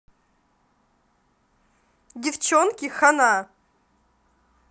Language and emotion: Russian, positive